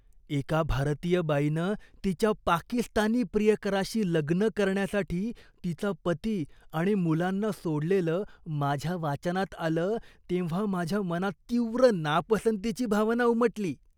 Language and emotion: Marathi, disgusted